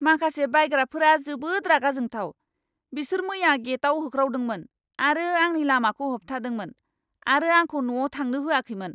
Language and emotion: Bodo, angry